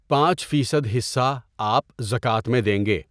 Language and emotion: Urdu, neutral